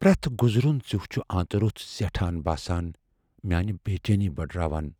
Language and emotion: Kashmiri, fearful